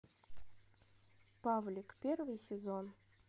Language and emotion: Russian, neutral